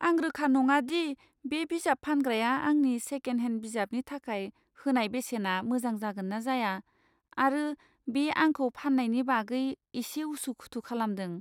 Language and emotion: Bodo, fearful